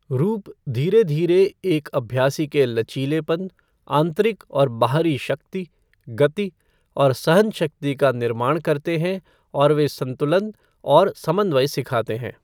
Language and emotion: Hindi, neutral